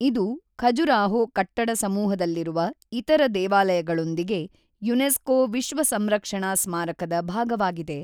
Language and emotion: Kannada, neutral